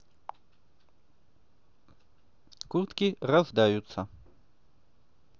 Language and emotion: Russian, neutral